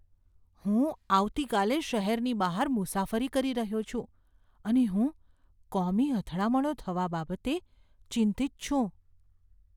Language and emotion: Gujarati, fearful